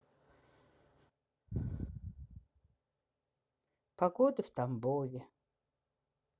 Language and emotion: Russian, sad